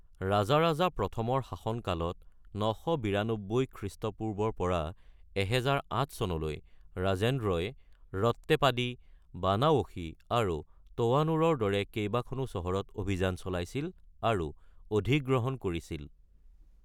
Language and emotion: Assamese, neutral